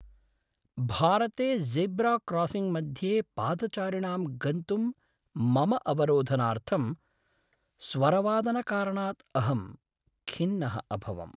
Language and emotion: Sanskrit, sad